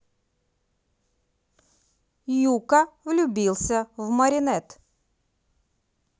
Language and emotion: Russian, positive